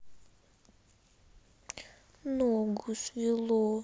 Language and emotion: Russian, sad